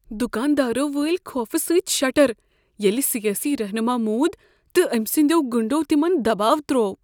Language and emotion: Kashmiri, fearful